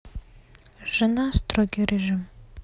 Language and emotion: Russian, neutral